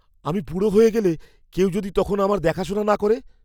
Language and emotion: Bengali, fearful